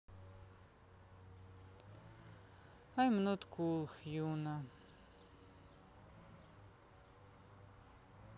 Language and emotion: Russian, sad